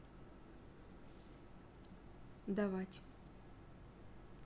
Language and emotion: Russian, neutral